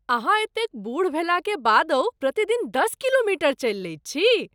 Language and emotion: Maithili, surprised